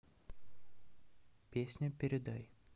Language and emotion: Russian, neutral